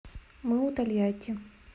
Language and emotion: Russian, neutral